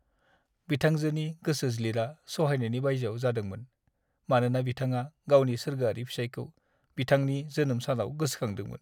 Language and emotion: Bodo, sad